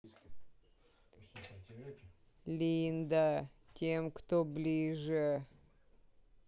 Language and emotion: Russian, sad